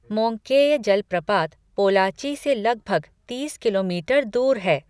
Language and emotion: Hindi, neutral